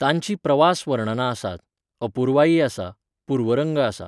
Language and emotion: Goan Konkani, neutral